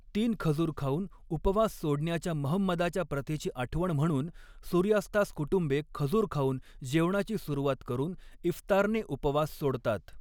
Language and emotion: Marathi, neutral